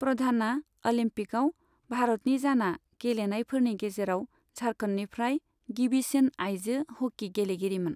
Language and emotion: Bodo, neutral